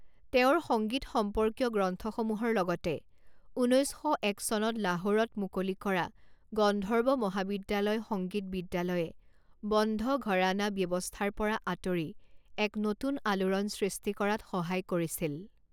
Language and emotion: Assamese, neutral